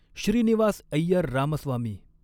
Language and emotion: Marathi, neutral